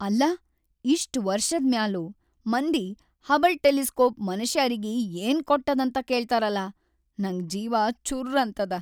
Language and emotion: Kannada, sad